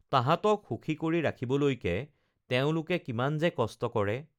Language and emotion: Assamese, neutral